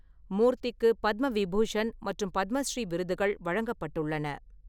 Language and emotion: Tamil, neutral